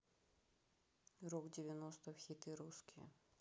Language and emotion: Russian, neutral